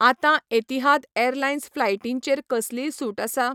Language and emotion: Goan Konkani, neutral